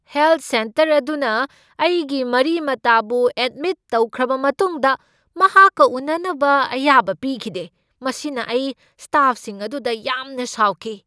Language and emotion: Manipuri, angry